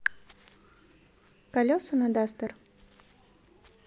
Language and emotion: Russian, neutral